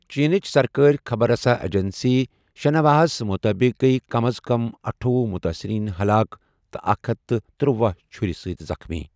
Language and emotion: Kashmiri, neutral